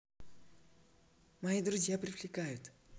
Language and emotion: Russian, positive